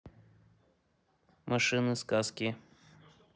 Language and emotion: Russian, neutral